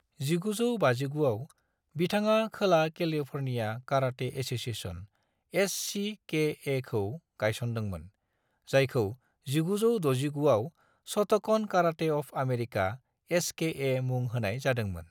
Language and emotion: Bodo, neutral